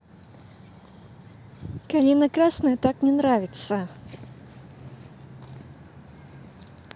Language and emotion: Russian, neutral